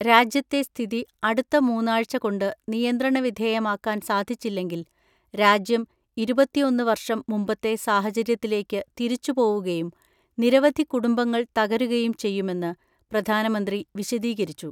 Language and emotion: Malayalam, neutral